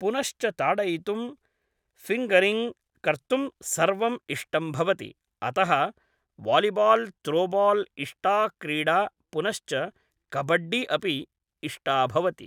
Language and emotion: Sanskrit, neutral